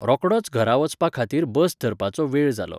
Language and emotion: Goan Konkani, neutral